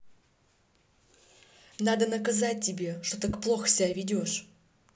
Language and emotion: Russian, angry